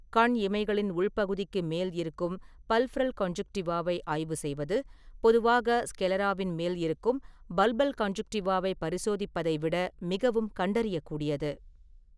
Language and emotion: Tamil, neutral